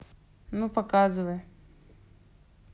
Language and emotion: Russian, neutral